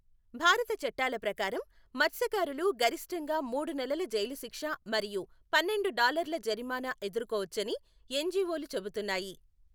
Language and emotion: Telugu, neutral